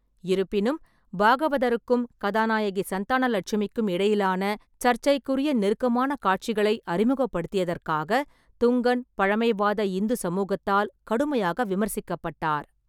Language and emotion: Tamil, neutral